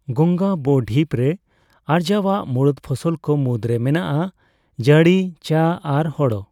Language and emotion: Santali, neutral